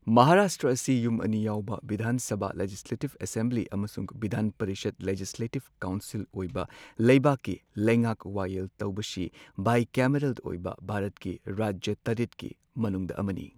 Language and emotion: Manipuri, neutral